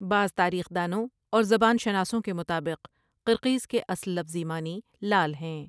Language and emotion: Urdu, neutral